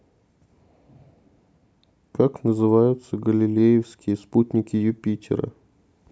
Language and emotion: Russian, neutral